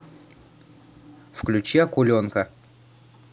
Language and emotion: Russian, neutral